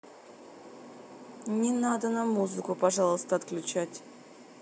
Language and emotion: Russian, neutral